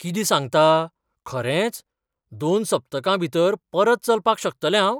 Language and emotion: Goan Konkani, surprised